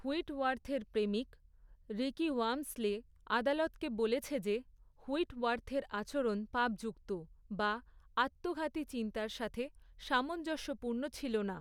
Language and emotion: Bengali, neutral